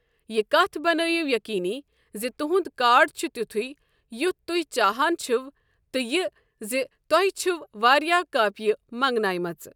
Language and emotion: Kashmiri, neutral